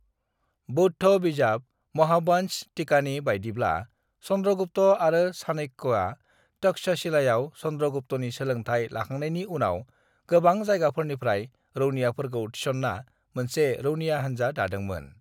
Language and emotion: Bodo, neutral